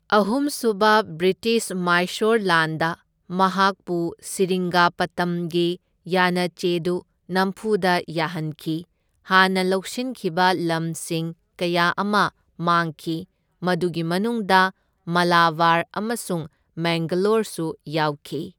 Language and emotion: Manipuri, neutral